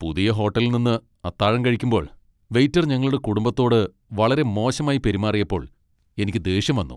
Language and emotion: Malayalam, angry